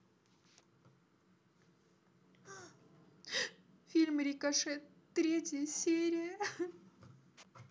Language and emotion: Russian, sad